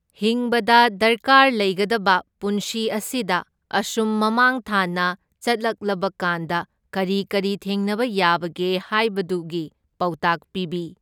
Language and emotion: Manipuri, neutral